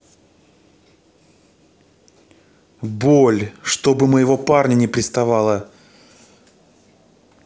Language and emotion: Russian, angry